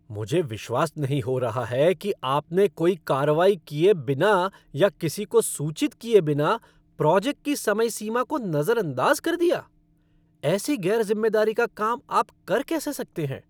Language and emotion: Hindi, angry